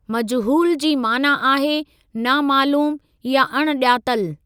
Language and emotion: Sindhi, neutral